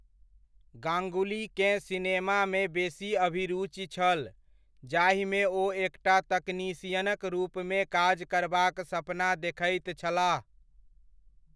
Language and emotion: Maithili, neutral